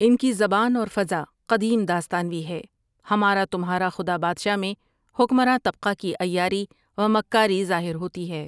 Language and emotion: Urdu, neutral